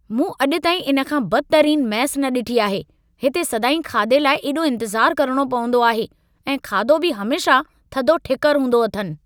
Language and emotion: Sindhi, angry